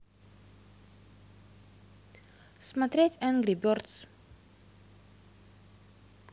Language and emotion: Russian, neutral